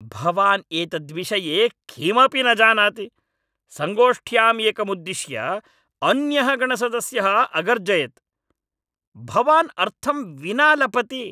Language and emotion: Sanskrit, angry